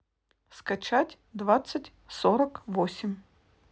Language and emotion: Russian, neutral